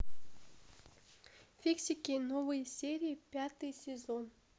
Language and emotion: Russian, neutral